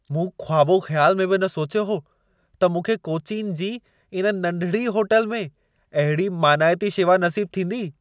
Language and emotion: Sindhi, surprised